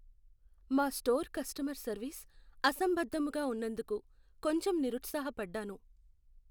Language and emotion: Telugu, sad